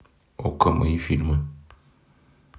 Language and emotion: Russian, neutral